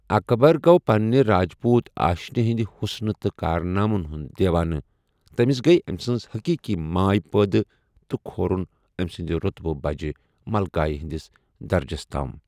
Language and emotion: Kashmiri, neutral